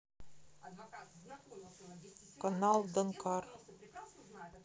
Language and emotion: Russian, neutral